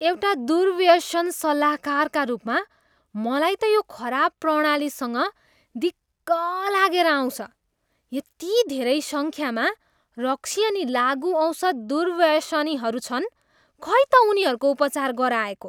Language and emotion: Nepali, disgusted